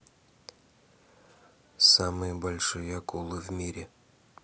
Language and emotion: Russian, neutral